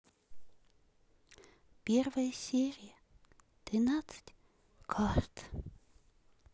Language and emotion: Russian, sad